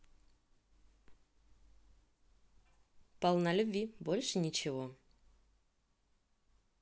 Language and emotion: Russian, positive